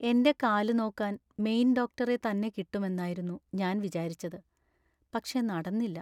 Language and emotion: Malayalam, sad